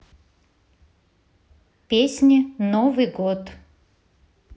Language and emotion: Russian, neutral